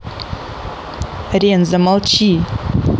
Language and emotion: Russian, angry